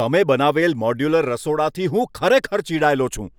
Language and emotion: Gujarati, angry